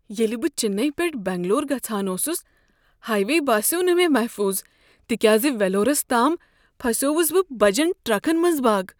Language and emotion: Kashmiri, fearful